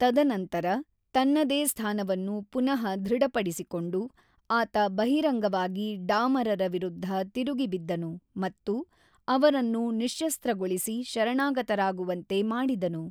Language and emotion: Kannada, neutral